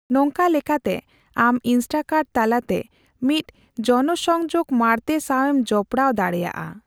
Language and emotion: Santali, neutral